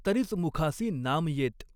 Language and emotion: Marathi, neutral